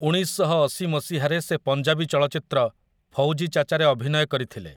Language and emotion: Odia, neutral